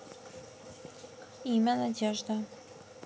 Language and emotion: Russian, neutral